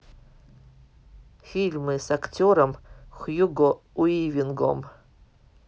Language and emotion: Russian, neutral